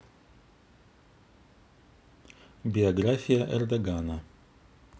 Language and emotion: Russian, neutral